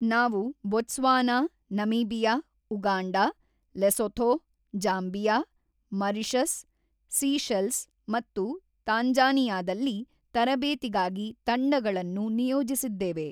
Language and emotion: Kannada, neutral